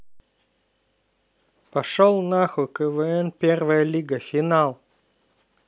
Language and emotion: Russian, neutral